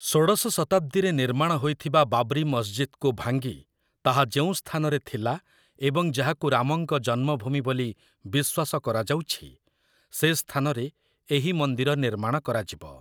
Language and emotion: Odia, neutral